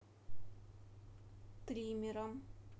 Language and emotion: Russian, neutral